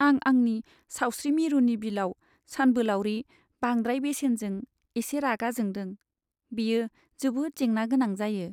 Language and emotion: Bodo, sad